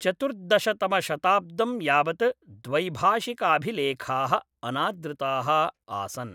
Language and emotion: Sanskrit, neutral